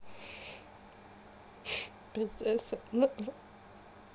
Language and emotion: Russian, sad